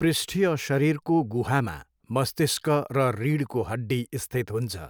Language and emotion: Nepali, neutral